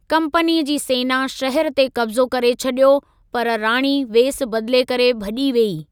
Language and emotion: Sindhi, neutral